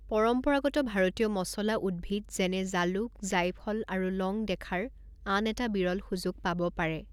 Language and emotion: Assamese, neutral